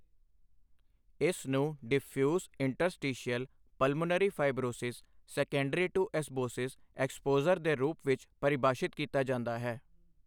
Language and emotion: Punjabi, neutral